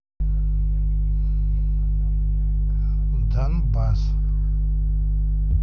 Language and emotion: Russian, neutral